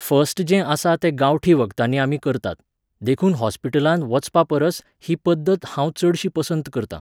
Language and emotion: Goan Konkani, neutral